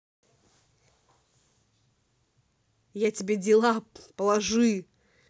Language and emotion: Russian, angry